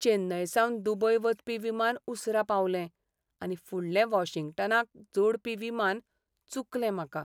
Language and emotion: Goan Konkani, sad